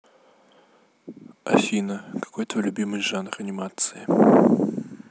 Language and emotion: Russian, neutral